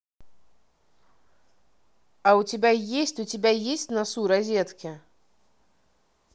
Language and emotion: Russian, neutral